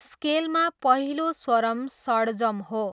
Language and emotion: Nepali, neutral